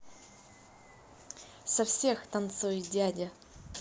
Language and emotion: Russian, positive